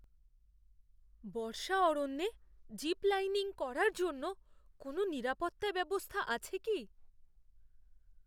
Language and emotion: Bengali, fearful